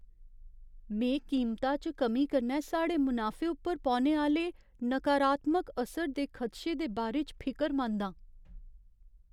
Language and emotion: Dogri, fearful